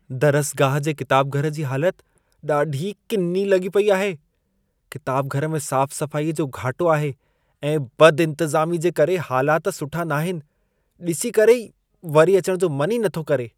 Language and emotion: Sindhi, disgusted